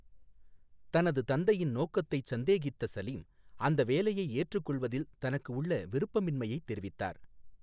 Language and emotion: Tamil, neutral